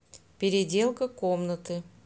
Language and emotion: Russian, neutral